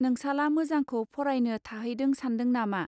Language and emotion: Bodo, neutral